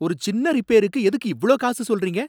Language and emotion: Tamil, angry